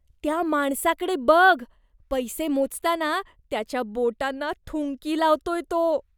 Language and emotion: Marathi, disgusted